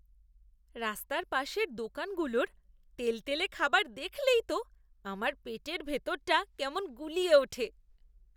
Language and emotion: Bengali, disgusted